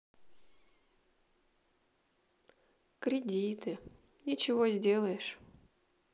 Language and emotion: Russian, sad